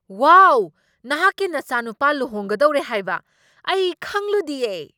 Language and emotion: Manipuri, surprised